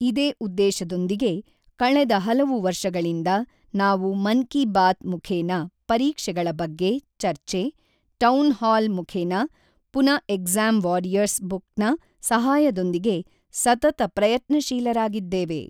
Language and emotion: Kannada, neutral